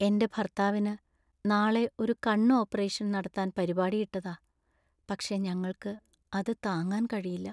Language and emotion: Malayalam, sad